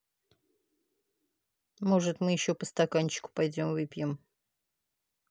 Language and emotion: Russian, neutral